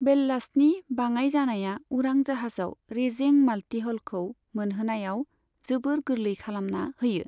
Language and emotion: Bodo, neutral